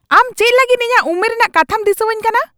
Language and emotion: Santali, angry